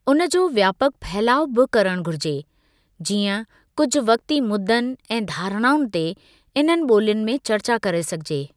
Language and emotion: Sindhi, neutral